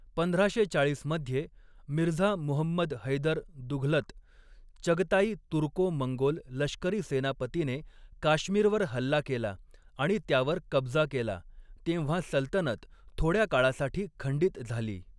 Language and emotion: Marathi, neutral